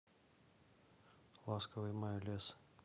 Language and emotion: Russian, neutral